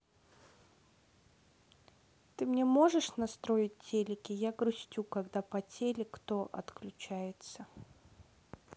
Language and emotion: Russian, sad